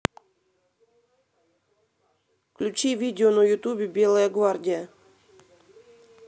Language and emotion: Russian, neutral